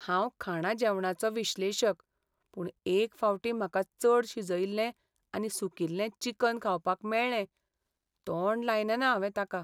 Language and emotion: Goan Konkani, sad